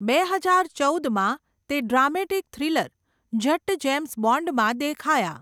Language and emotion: Gujarati, neutral